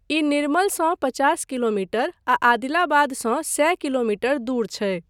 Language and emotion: Maithili, neutral